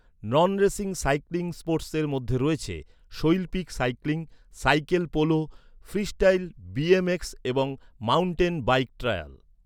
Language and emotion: Bengali, neutral